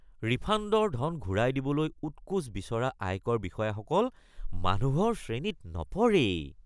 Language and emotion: Assamese, disgusted